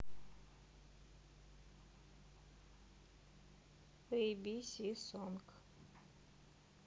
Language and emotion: Russian, neutral